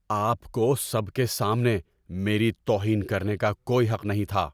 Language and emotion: Urdu, angry